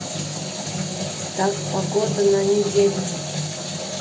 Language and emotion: Russian, neutral